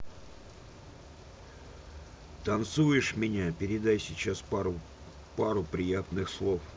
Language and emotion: Russian, neutral